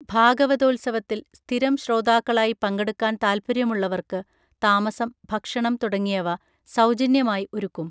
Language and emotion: Malayalam, neutral